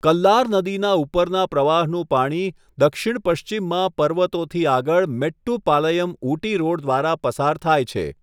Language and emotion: Gujarati, neutral